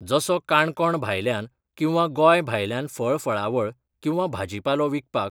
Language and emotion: Goan Konkani, neutral